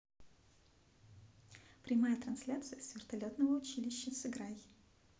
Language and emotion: Russian, positive